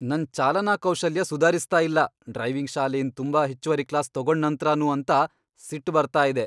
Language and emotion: Kannada, angry